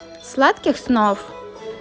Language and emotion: Russian, positive